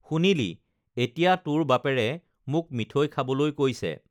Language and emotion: Assamese, neutral